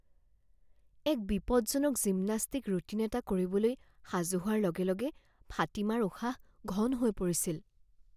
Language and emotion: Assamese, fearful